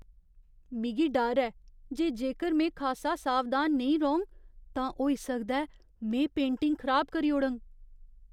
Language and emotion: Dogri, fearful